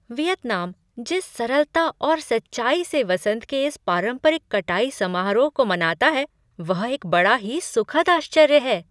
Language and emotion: Hindi, surprised